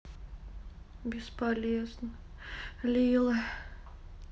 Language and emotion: Russian, sad